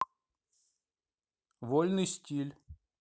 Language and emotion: Russian, neutral